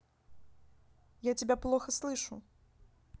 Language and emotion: Russian, neutral